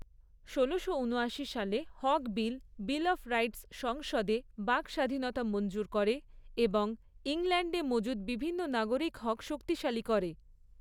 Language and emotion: Bengali, neutral